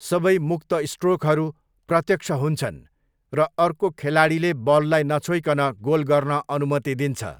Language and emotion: Nepali, neutral